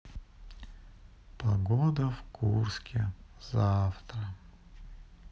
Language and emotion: Russian, sad